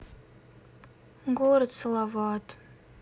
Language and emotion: Russian, sad